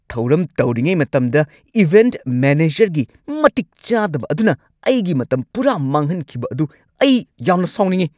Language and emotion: Manipuri, angry